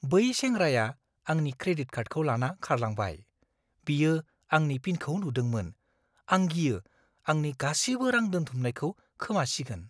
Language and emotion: Bodo, fearful